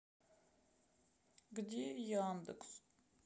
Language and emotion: Russian, sad